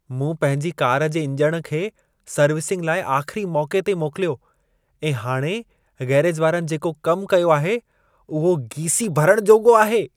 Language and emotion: Sindhi, disgusted